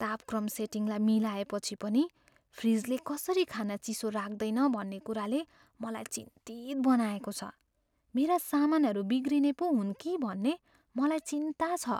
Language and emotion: Nepali, fearful